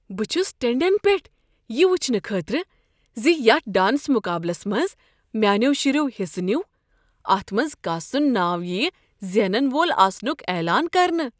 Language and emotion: Kashmiri, surprised